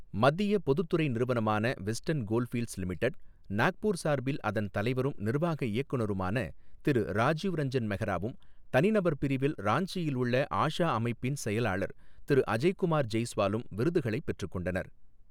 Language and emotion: Tamil, neutral